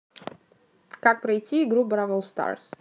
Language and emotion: Russian, neutral